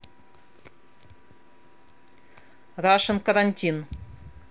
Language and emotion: Russian, angry